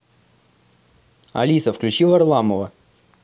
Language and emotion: Russian, positive